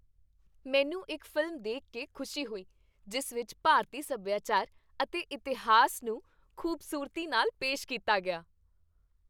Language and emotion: Punjabi, happy